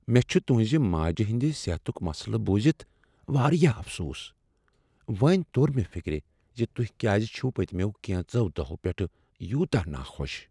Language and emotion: Kashmiri, sad